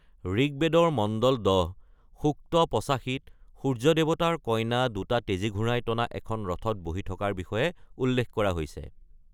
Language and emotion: Assamese, neutral